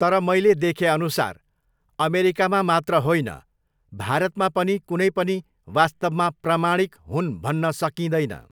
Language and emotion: Nepali, neutral